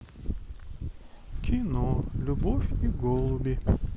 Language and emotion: Russian, sad